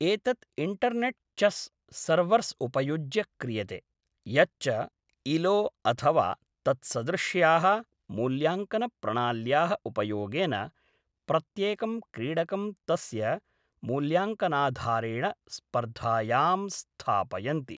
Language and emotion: Sanskrit, neutral